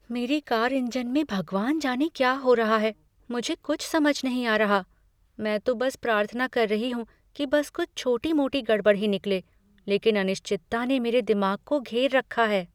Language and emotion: Hindi, fearful